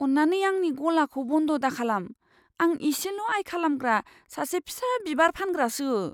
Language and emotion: Bodo, fearful